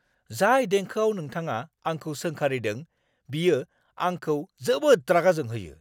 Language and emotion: Bodo, angry